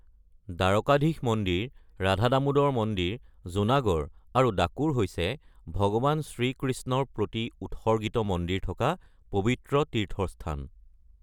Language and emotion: Assamese, neutral